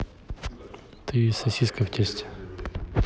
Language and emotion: Russian, neutral